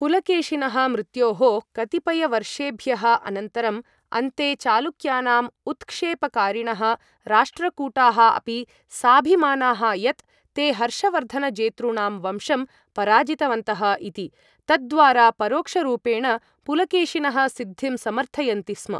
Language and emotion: Sanskrit, neutral